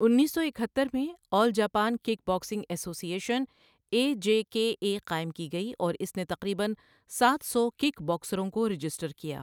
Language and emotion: Urdu, neutral